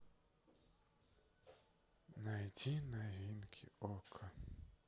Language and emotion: Russian, sad